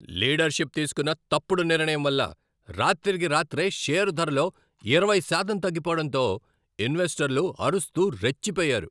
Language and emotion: Telugu, angry